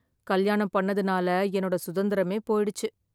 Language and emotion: Tamil, sad